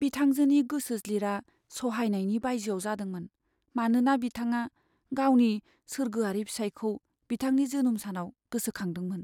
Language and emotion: Bodo, sad